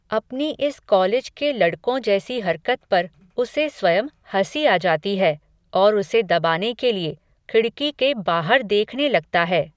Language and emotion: Hindi, neutral